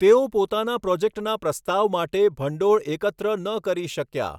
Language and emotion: Gujarati, neutral